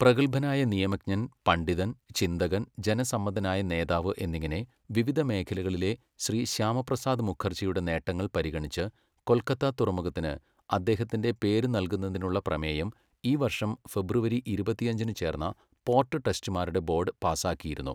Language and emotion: Malayalam, neutral